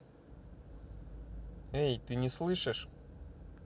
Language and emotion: Russian, neutral